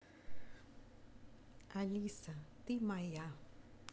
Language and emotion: Russian, positive